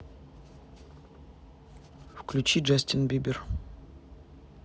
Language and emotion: Russian, neutral